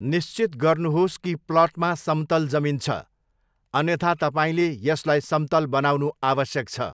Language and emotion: Nepali, neutral